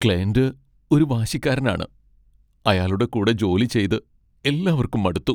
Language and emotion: Malayalam, sad